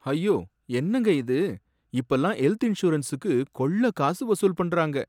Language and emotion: Tamil, sad